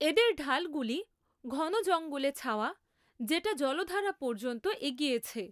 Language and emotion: Bengali, neutral